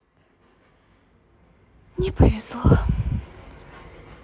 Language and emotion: Russian, sad